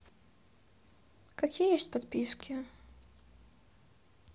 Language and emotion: Russian, neutral